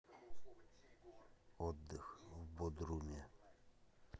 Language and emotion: Russian, neutral